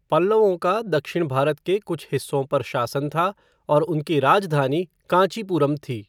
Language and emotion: Hindi, neutral